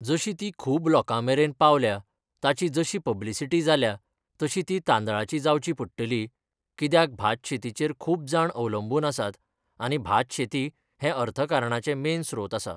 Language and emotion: Goan Konkani, neutral